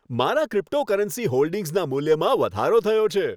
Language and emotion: Gujarati, happy